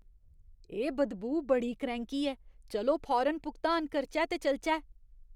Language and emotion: Dogri, disgusted